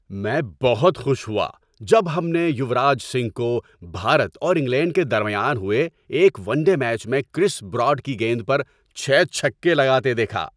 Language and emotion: Urdu, happy